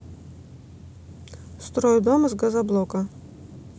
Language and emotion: Russian, neutral